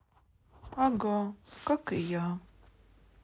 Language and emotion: Russian, sad